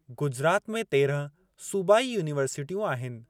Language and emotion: Sindhi, neutral